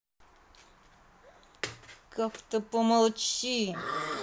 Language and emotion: Russian, angry